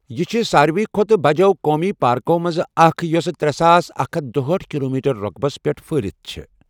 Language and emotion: Kashmiri, neutral